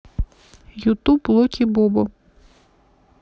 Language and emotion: Russian, neutral